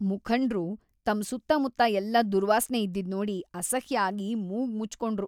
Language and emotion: Kannada, disgusted